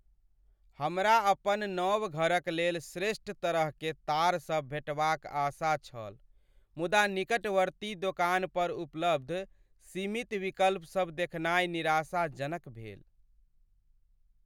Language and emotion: Maithili, sad